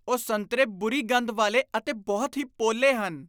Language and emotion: Punjabi, disgusted